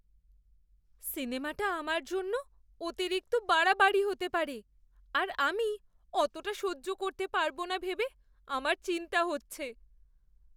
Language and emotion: Bengali, fearful